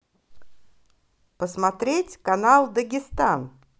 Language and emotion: Russian, positive